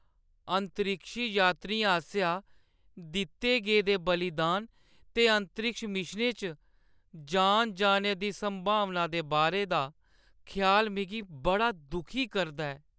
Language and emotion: Dogri, sad